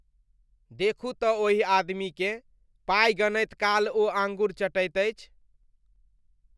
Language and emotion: Maithili, disgusted